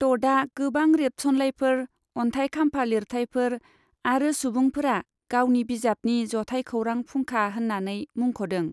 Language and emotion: Bodo, neutral